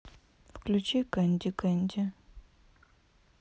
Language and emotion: Russian, neutral